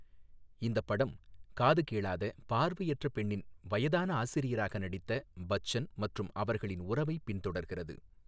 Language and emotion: Tamil, neutral